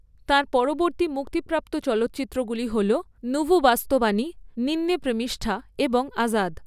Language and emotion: Bengali, neutral